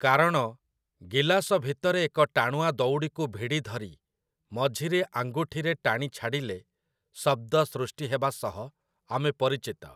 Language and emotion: Odia, neutral